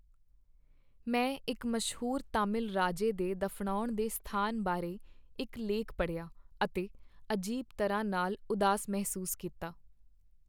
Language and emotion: Punjabi, sad